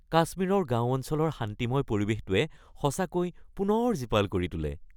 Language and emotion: Assamese, happy